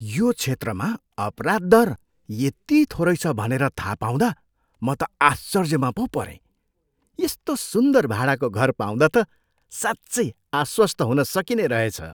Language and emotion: Nepali, surprised